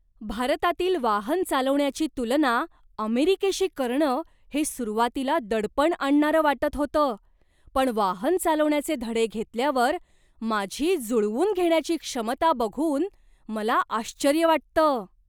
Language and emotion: Marathi, surprised